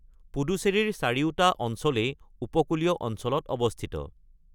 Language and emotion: Assamese, neutral